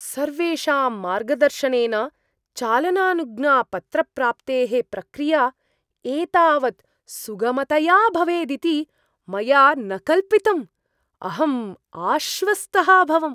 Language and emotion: Sanskrit, surprised